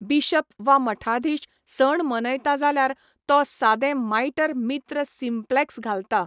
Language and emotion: Goan Konkani, neutral